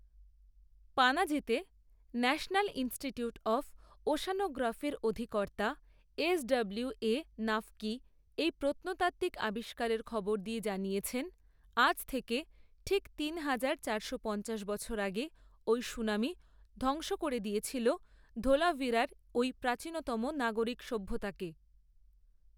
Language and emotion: Bengali, neutral